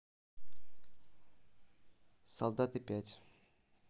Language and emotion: Russian, neutral